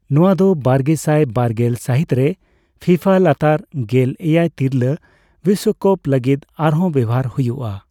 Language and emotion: Santali, neutral